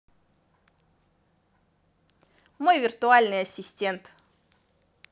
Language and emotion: Russian, positive